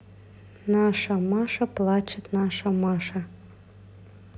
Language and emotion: Russian, neutral